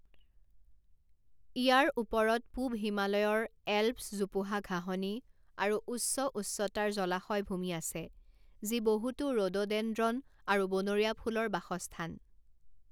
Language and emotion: Assamese, neutral